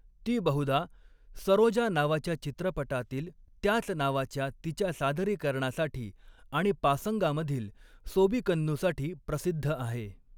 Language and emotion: Marathi, neutral